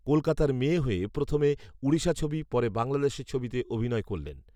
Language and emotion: Bengali, neutral